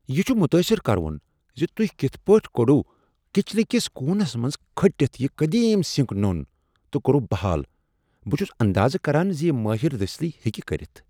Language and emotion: Kashmiri, surprised